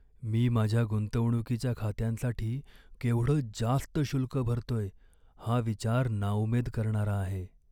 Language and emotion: Marathi, sad